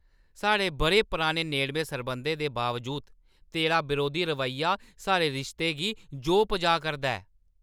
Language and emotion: Dogri, angry